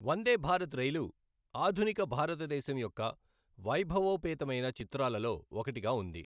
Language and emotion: Telugu, neutral